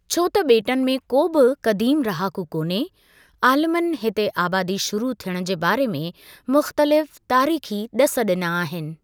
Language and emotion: Sindhi, neutral